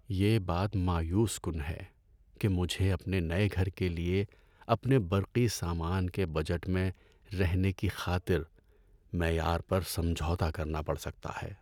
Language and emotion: Urdu, sad